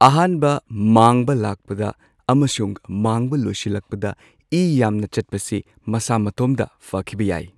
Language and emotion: Manipuri, neutral